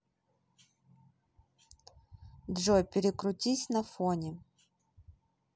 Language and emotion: Russian, neutral